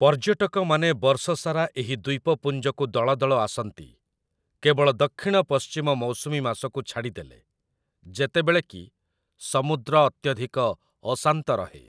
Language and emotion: Odia, neutral